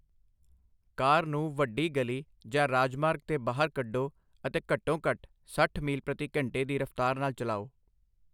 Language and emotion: Punjabi, neutral